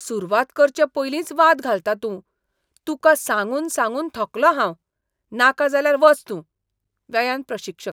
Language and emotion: Goan Konkani, disgusted